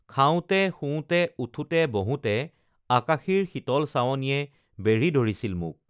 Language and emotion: Assamese, neutral